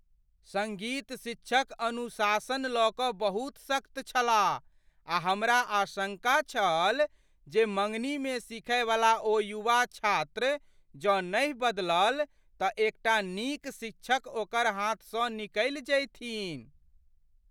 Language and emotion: Maithili, fearful